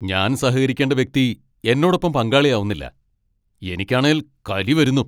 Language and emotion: Malayalam, angry